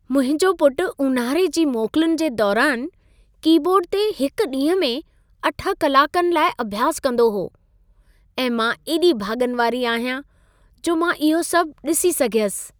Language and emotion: Sindhi, happy